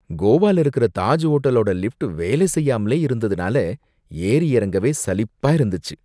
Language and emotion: Tamil, disgusted